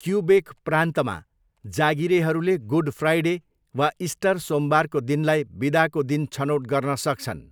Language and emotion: Nepali, neutral